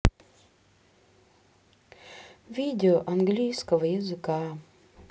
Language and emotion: Russian, sad